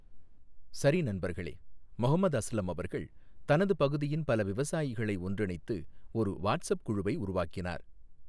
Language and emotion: Tamil, neutral